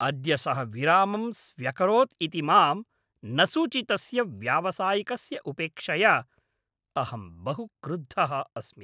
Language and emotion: Sanskrit, angry